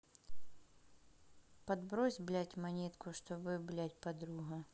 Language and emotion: Russian, neutral